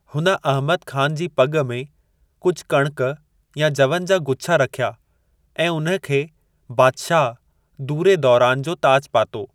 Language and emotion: Sindhi, neutral